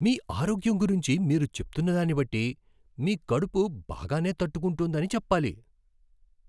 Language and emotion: Telugu, surprised